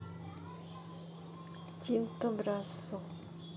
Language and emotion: Russian, neutral